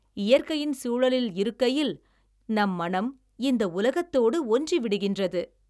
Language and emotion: Tamil, happy